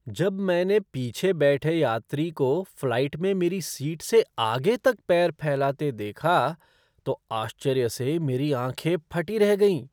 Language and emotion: Hindi, surprised